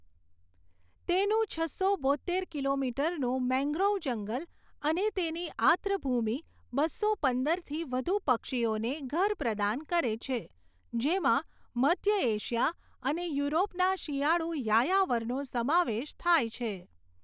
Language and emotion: Gujarati, neutral